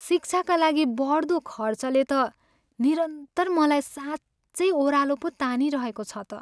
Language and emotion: Nepali, sad